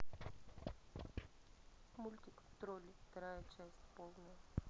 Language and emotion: Russian, neutral